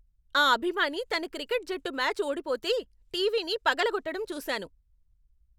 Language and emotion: Telugu, angry